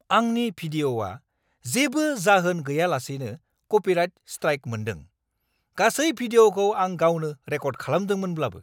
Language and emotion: Bodo, angry